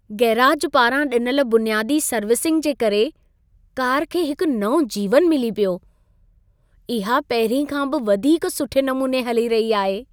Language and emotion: Sindhi, happy